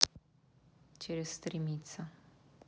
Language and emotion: Russian, neutral